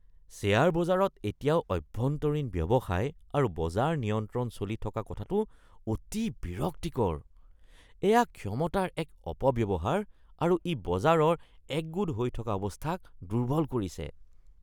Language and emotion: Assamese, disgusted